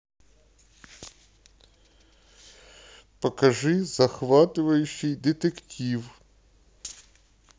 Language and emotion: Russian, neutral